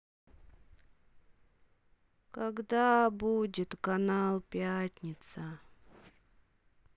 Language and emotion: Russian, sad